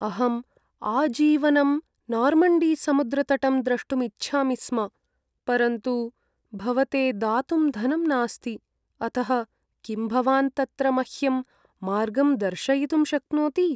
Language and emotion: Sanskrit, sad